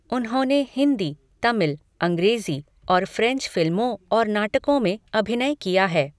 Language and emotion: Hindi, neutral